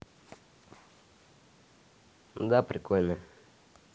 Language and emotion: Russian, neutral